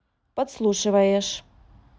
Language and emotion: Russian, neutral